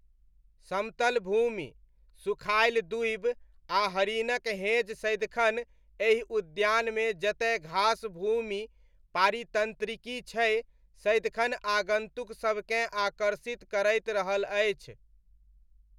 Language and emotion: Maithili, neutral